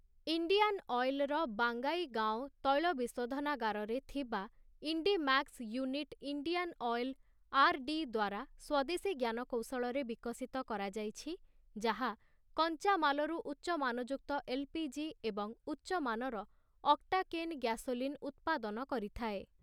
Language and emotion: Odia, neutral